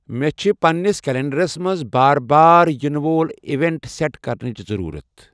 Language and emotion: Kashmiri, neutral